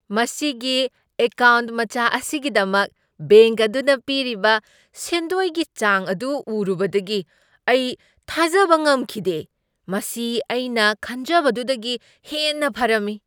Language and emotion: Manipuri, surprised